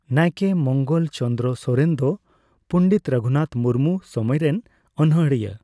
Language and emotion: Santali, neutral